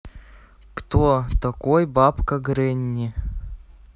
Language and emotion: Russian, neutral